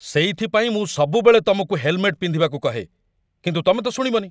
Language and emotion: Odia, angry